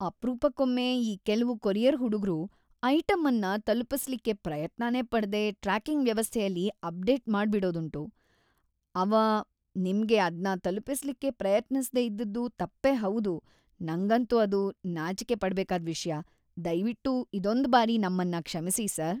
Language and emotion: Kannada, disgusted